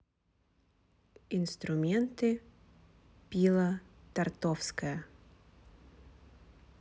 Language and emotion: Russian, neutral